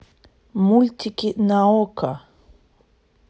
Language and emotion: Russian, neutral